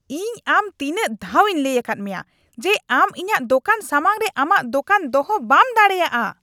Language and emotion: Santali, angry